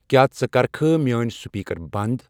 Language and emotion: Kashmiri, neutral